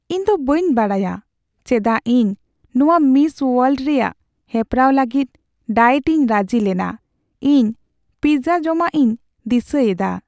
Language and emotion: Santali, sad